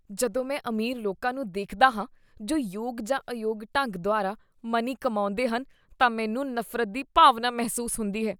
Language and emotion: Punjabi, disgusted